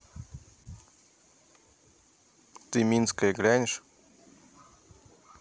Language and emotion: Russian, neutral